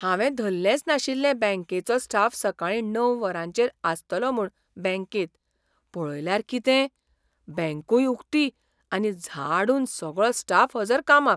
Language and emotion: Goan Konkani, surprised